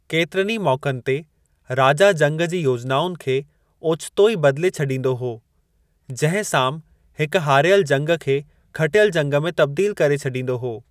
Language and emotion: Sindhi, neutral